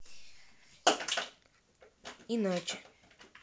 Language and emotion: Russian, neutral